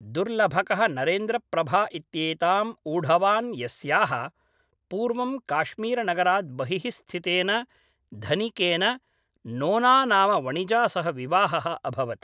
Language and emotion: Sanskrit, neutral